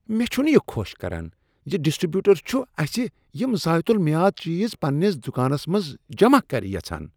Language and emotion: Kashmiri, disgusted